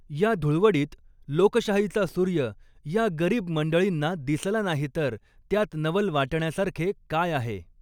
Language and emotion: Marathi, neutral